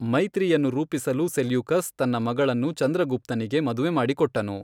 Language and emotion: Kannada, neutral